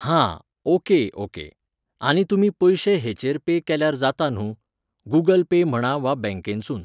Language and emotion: Goan Konkani, neutral